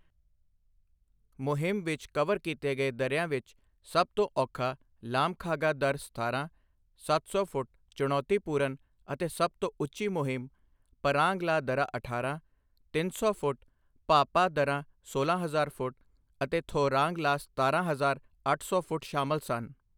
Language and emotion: Punjabi, neutral